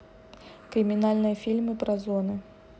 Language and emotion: Russian, neutral